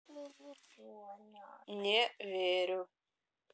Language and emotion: Russian, neutral